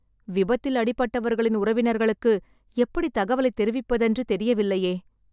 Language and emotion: Tamil, sad